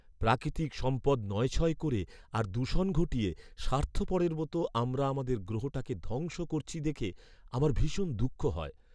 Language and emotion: Bengali, sad